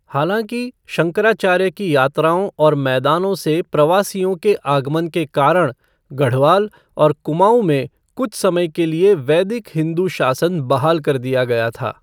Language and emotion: Hindi, neutral